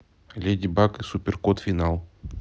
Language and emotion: Russian, neutral